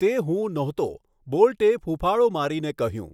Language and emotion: Gujarati, neutral